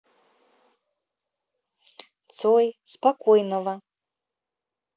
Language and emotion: Russian, neutral